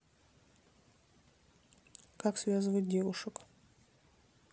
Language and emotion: Russian, neutral